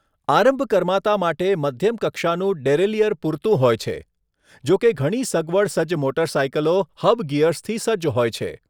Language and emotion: Gujarati, neutral